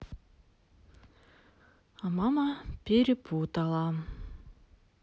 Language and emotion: Russian, sad